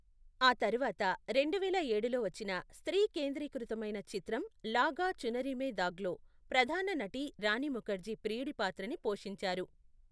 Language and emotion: Telugu, neutral